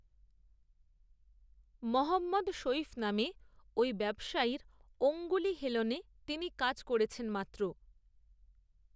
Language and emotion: Bengali, neutral